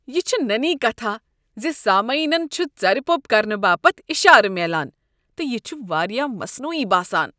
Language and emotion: Kashmiri, disgusted